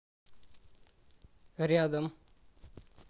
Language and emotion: Russian, neutral